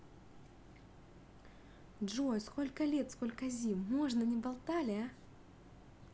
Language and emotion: Russian, positive